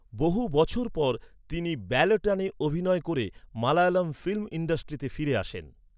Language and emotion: Bengali, neutral